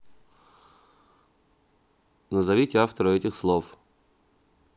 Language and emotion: Russian, neutral